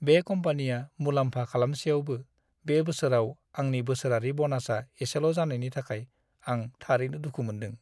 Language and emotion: Bodo, sad